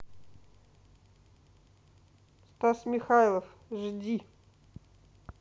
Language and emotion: Russian, neutral